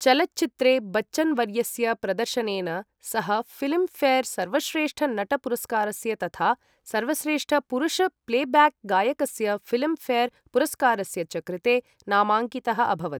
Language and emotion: Sanskrit, neutral